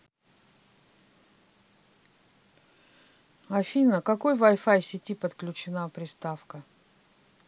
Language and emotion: Russian, neutral